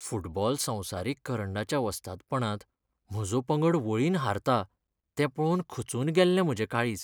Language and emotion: Goan Konkani, sad